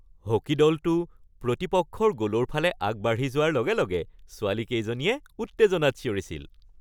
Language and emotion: Assamese, happy